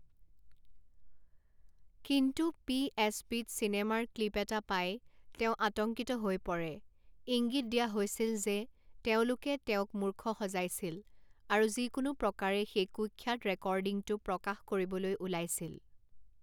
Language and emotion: Assamese, neutral